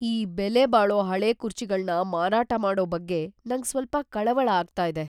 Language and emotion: Kannada, fearful